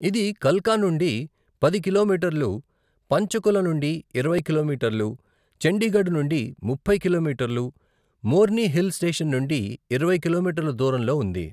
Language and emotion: Telugu, neutral